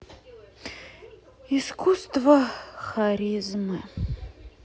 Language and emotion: Russian, sad